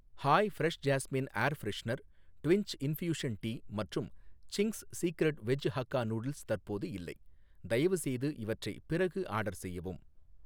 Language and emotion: Tamil, neutral